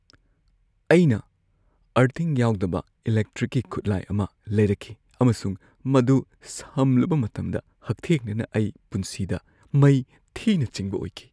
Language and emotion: Manipuri, fearful